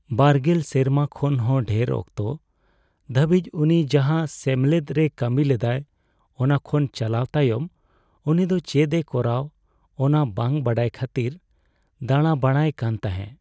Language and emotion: Santali, sad